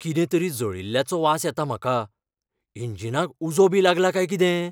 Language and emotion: Goan Konkani, fearful